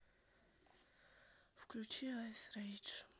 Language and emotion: Russian, sad